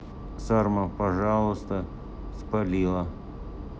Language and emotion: Russian, neutral